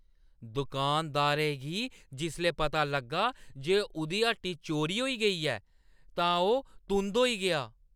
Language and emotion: Dogri, angry